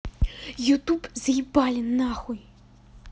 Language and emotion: Russian, angry